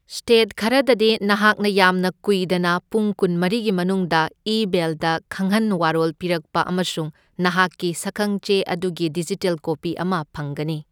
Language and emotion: Manipuri, neutral